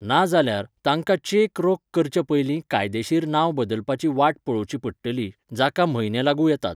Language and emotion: Goan Konkani, neutral